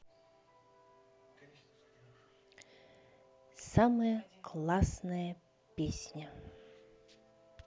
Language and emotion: Russian, neutral